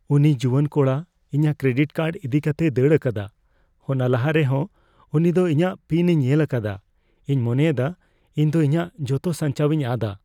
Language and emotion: Santali, fearful